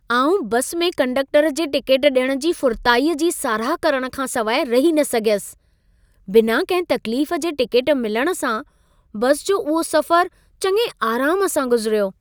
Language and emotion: Sindhi, happy